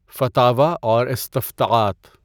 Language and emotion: Urdu, neutral